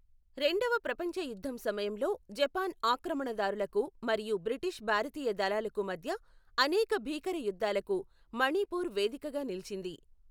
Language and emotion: Telugu, neutral